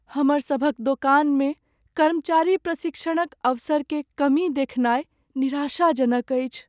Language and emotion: Maithili, sad